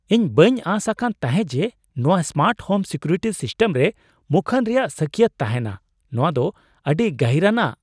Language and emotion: Santali, surprised